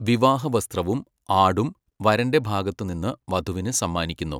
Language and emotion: Malayalam, neutral